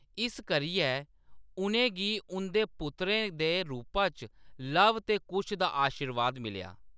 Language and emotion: Dogri, neutral